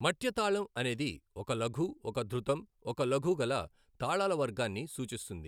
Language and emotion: Telugu, neutral